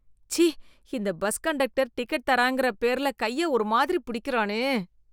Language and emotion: Tamil, disgusted